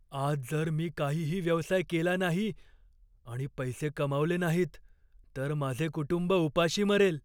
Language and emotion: Marathi, fearful